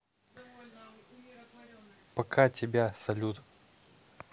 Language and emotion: Russian, neutral